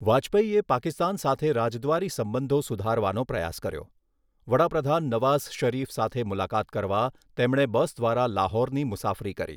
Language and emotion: Gujarati, neutral